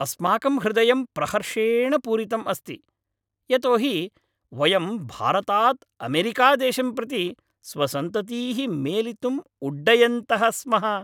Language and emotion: Sanskrit, happy